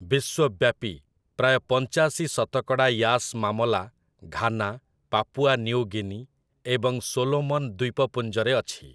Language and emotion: Odia, neutral